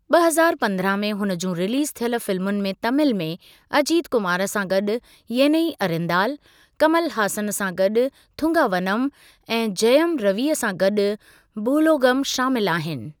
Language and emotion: Sindhi, neutral